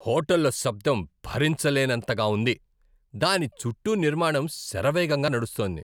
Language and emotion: Telugu, angry